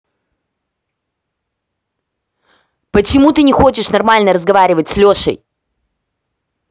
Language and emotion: Russian, angry